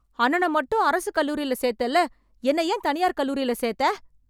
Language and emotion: Tamil, angry